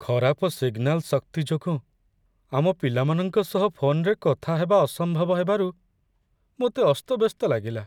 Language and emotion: Odia, sad